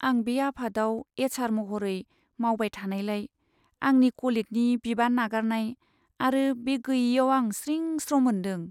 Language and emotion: Bodo, sad